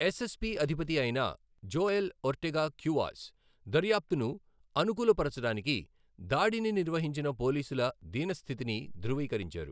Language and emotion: Telugu, neutral